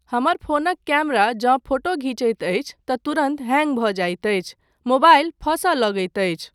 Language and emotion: Maithili, neutral